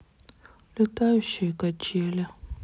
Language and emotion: Russian, sad